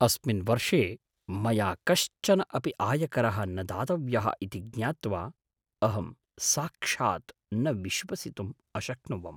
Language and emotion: Sanskrit, surprised